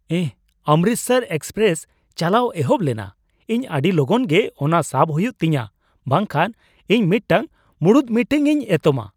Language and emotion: Santali, surprised